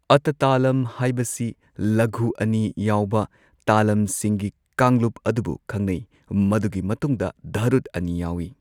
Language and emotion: Manipuri, neutral